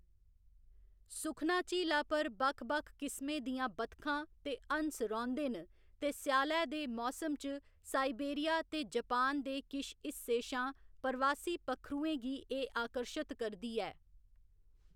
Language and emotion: Dogri, neutral